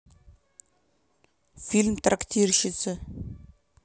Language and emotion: Russian, neutral